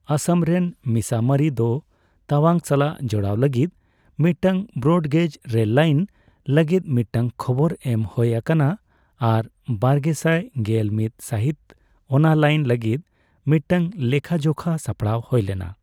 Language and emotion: Santali, neutral